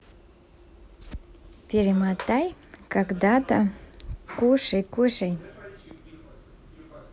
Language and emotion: Russian, positive